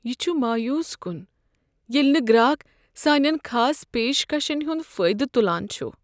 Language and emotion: Kashmiri, sad